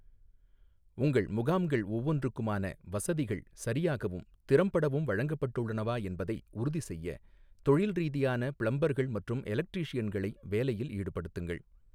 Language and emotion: Tamil, neutral